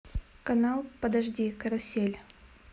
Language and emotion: Russian, neutral